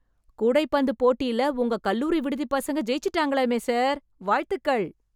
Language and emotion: Tamil, happy